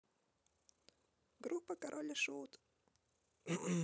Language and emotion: Russian, positive